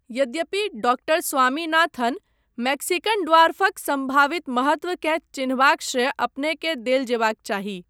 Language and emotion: Maithili, neutral